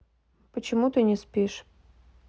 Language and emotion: Russian, neutral